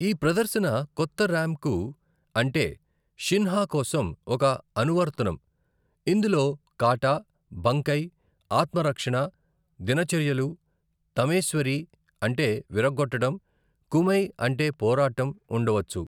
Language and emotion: Telugu, neutral